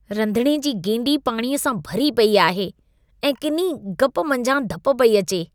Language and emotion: Sindhi, disgusted